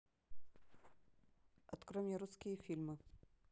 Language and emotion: Russian, neutral